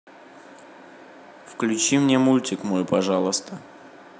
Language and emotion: Russian, neutral